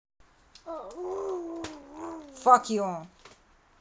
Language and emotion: Russian, angry